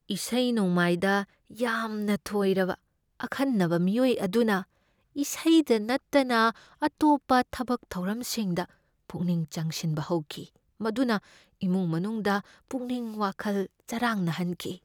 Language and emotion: Manipuri, fearful